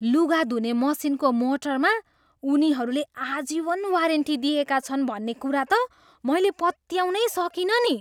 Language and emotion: Nepali, surprised